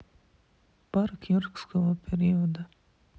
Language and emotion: Russian, neutral